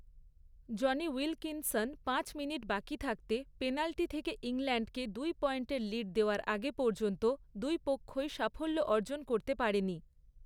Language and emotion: Bengali, neutral